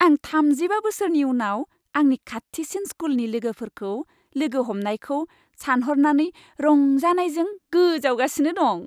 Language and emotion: Bodo, happy